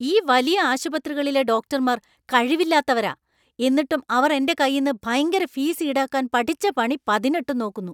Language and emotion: Malayalam, angry